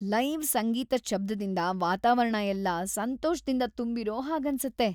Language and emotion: Kannada, happy